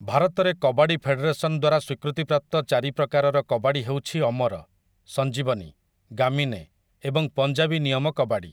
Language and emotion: Odia, neutral